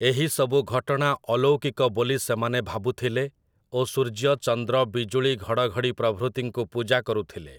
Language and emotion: Odia, neutral